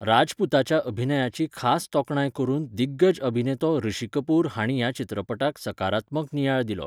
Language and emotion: Goan Konkani, neutral